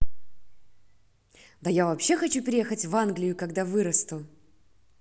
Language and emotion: Russian, positive